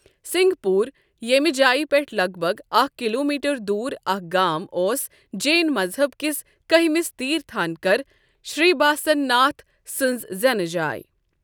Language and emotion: Kashmiri, neutral